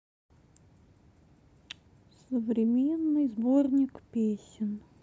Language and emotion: Russian, sad